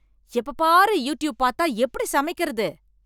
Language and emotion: Tamil, angry